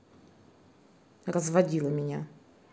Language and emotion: Russian, angry